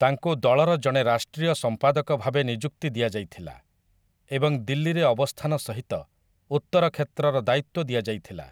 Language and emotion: Odia, neutral